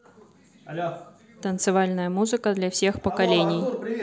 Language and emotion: Russian, neutral